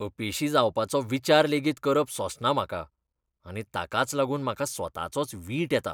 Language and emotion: Goan Konkani, disgusted